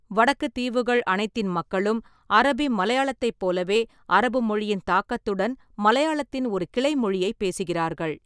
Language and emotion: Tamil, neutral